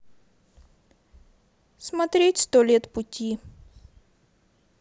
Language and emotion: Russian, neutral